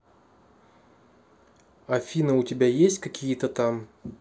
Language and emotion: Russian, neutral